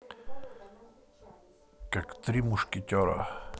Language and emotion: Russian, neutral